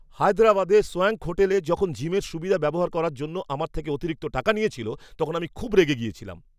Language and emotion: Bengali, angry